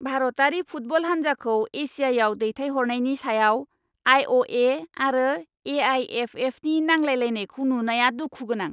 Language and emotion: Bodo, angry